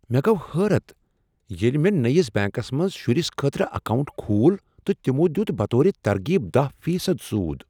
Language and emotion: Kashmiri, surprised